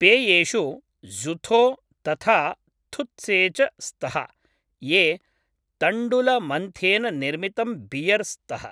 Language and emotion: Sanskrit, neutral